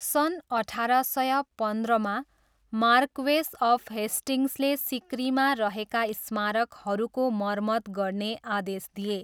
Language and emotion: Nepali, neutral